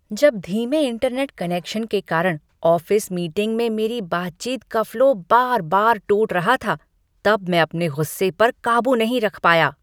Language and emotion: Hindi, angry